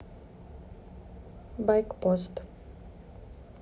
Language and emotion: Russian, neutral